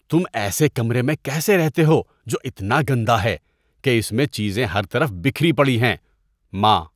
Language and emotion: Urdu, disgusted